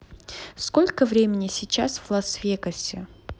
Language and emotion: Russian, neutral